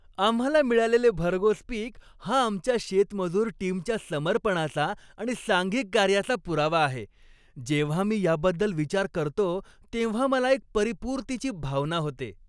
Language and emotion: Marathi, happy